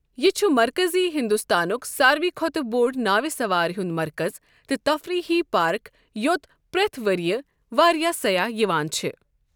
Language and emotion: Kashmiri, neutral